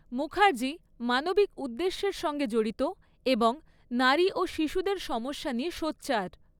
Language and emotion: Bengali, neutral